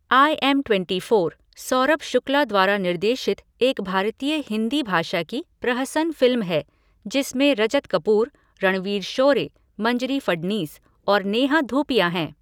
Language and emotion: Hindi, neutral